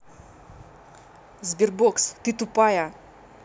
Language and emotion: Russian, angry